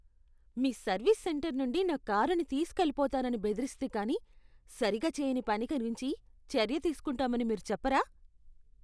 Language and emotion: Telugu, disgusted